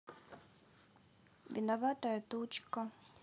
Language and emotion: Russian, sad